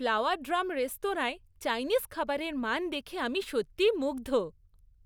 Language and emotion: Bengali, happy